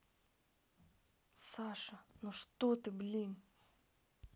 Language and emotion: Russian, angry